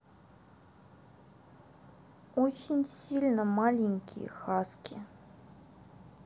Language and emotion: Russian, neutral